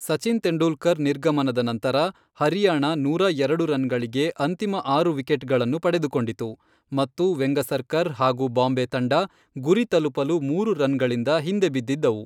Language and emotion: Kannada, neutral